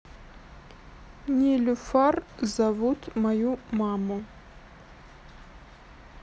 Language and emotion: Russian, neutral